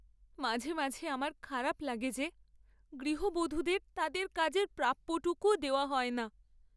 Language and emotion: Bengali, sad